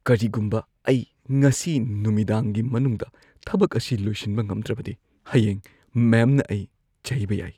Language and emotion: Manipuri, fearful